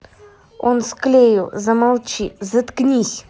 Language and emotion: Russian, angry